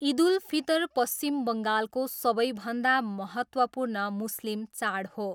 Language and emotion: Nepali, neutral